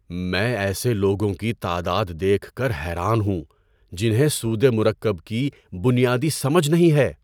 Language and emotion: Urdu, surprised